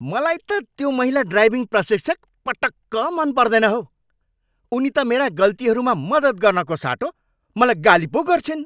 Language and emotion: Nepali, angry